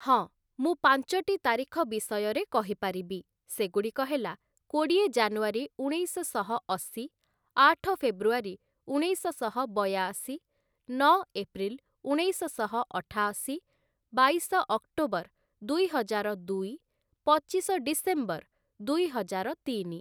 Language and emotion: Odia, neutral